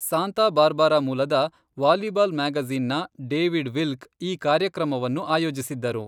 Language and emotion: Kannada, neutral